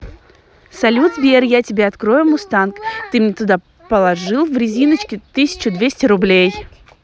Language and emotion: Russian, positive